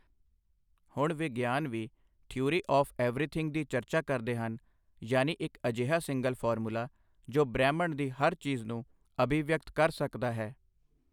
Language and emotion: Punjabi, neutral